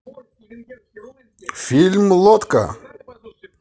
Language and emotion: Russian, positive